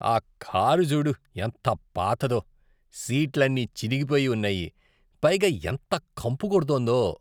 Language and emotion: Telugu, disgusted